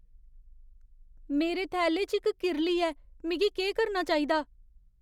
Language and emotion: Dogri, fearful